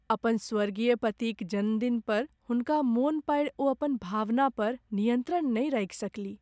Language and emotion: Maithili, sad